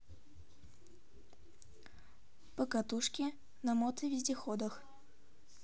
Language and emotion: Russian, neutral